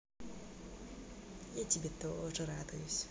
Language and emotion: Russian, positive